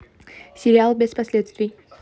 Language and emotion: Russian, neutral